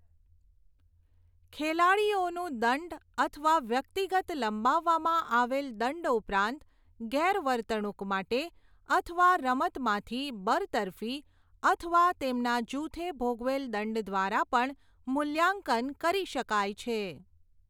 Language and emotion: Gujarati, neutral